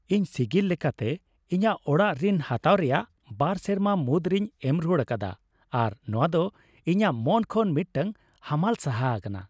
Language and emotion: Santali, happy